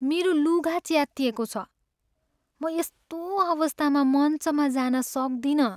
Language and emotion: Nepali, sad